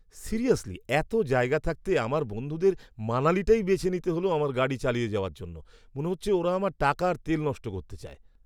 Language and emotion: Bengali, angry